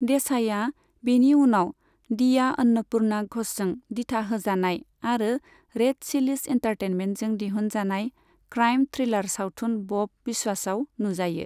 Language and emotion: Bodo, neutral